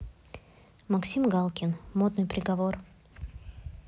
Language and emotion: Russian, neutral